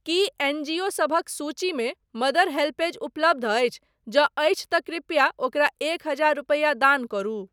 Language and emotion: Maithili, neutral